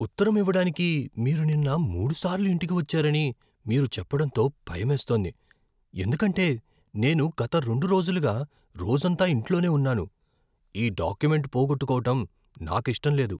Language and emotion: Telugu, fearful